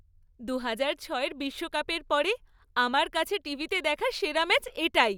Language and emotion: Bengali, happy